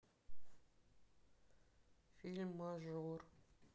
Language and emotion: Russian, sad